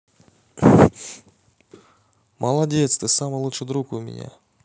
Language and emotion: Russian, positive